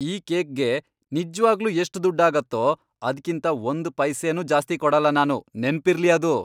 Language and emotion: Kannada, angry